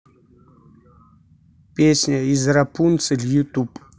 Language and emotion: Russian, neutral